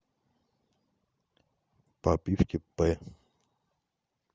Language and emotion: Russian, neutral